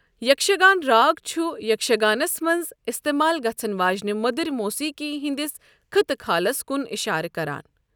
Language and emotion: Kashmiri, neutral